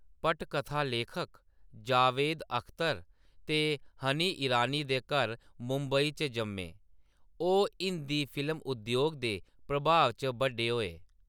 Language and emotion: Dogri, neutral